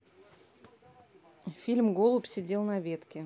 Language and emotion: Russian, neutral